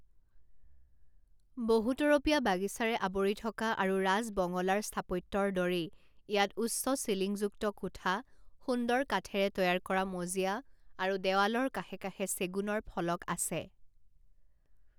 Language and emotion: Assamese, neutral